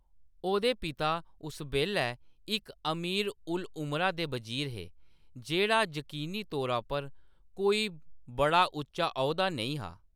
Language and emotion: Dogri, neutral